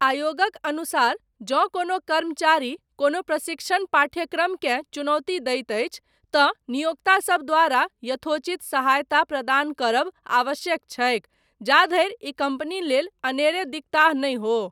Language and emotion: Maithili, neutral